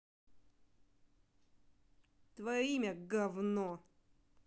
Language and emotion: Russian, angry